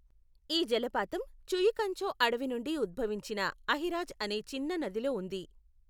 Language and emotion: Telugu, neutral